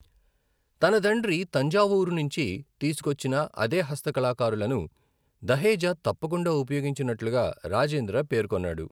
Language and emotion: Telugu, neutral